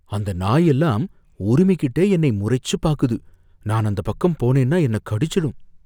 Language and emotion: Tamil, fearful